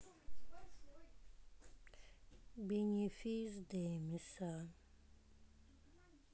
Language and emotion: Russian, sad